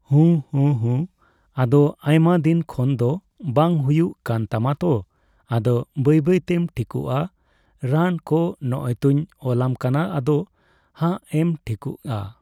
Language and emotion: Santali, neutral